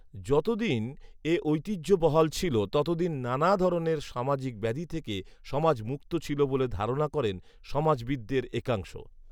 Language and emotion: Bengali, neutral